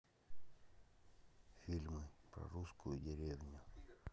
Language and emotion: Russian, neutral